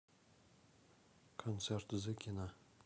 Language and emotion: Russian, neutral